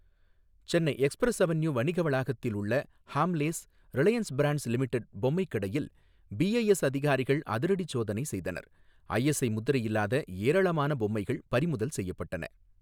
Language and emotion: Tamil, neutral